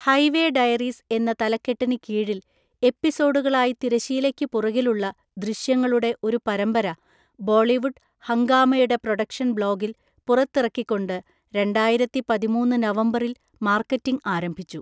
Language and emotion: Malayalam, neutral